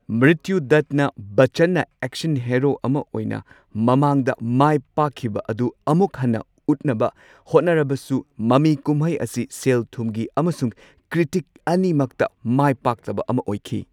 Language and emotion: Manipuri, neutral